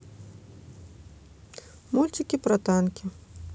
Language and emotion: Russian, neutral